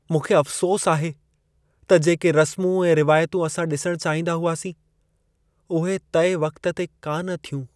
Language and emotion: Sindhi, sad